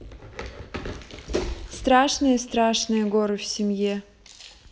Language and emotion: Russian, neutral